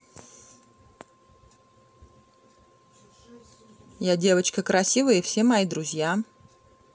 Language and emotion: Russian, neutral